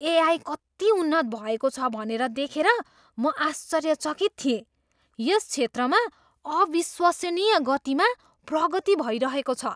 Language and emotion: Nepali, surprised